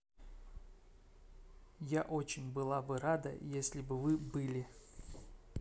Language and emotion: Russian, neutral